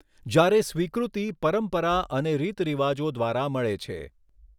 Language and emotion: Gujarati, neutral